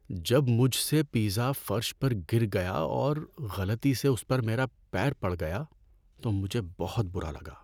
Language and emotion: Urdu, sad